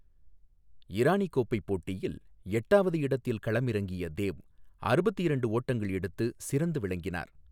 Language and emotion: Tamil, neutral